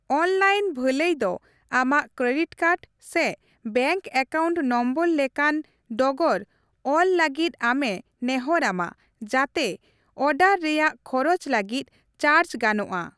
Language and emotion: Santali, neutral